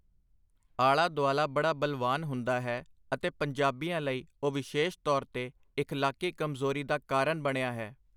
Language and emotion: Punjabi, neutral